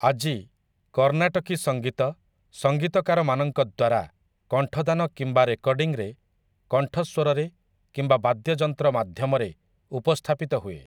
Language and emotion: Odia, neutral